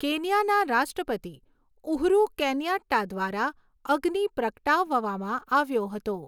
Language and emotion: Gujarati, neutral